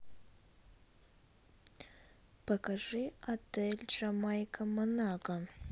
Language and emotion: Russian, neutral